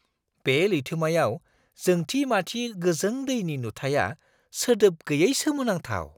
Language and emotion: Bodo, surprised